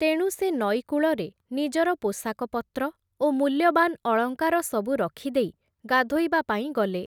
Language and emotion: Odia, neutral